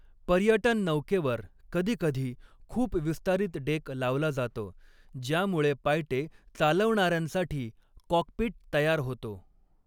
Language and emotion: Marathi, neutral